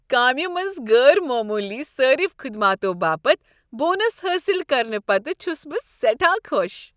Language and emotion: Kashmiri, happy